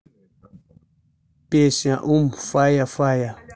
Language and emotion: Russian, neutral